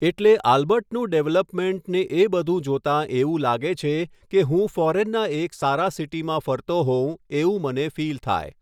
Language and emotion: Gujarati, neutral